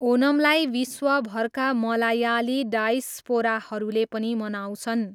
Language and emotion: Nepali, neutral